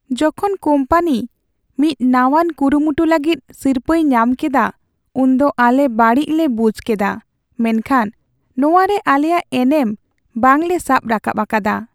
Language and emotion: Santali, sad